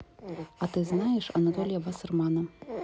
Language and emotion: Russian, neutral